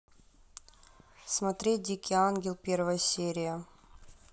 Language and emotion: Russian, neutral